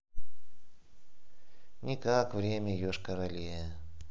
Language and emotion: Russian, neutral